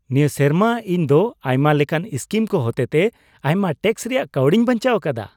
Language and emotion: Santali, happy